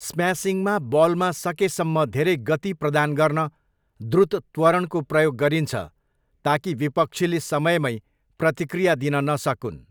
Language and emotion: Nepali, neutral